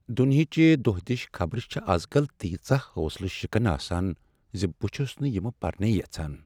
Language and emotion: Kashmiri, sad